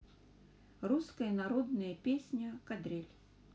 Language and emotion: Russian, neutral